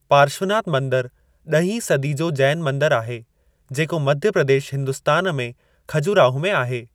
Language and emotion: Sindhi, neutral